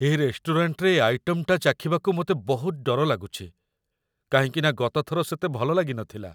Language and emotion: Odia, fearful